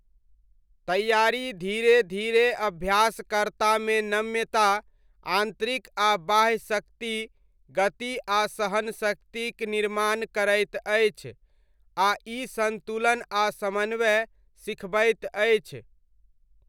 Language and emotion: Maithili, neutral